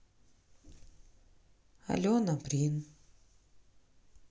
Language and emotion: Russian, sad